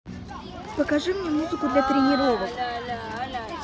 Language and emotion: Russian, neutral